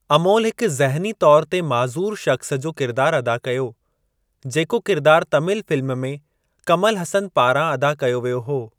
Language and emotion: Sindhi, neutral